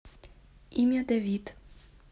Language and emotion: Russian, neutral